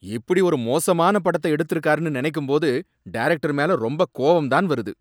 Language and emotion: Tamil, angry